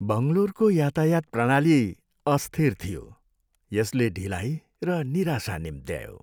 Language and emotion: Nepali, sad